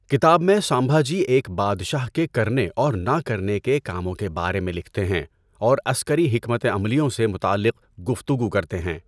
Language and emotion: Urdu, neutral